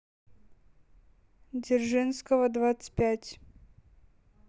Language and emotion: Russian, neutral